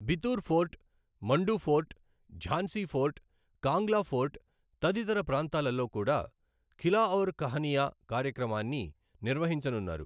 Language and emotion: Telugu, neutral